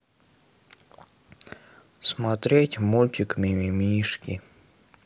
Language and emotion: Russian, sad